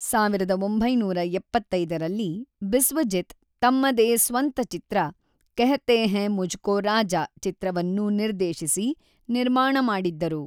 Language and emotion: Kannada, neutral